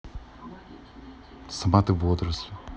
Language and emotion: Russian, neutral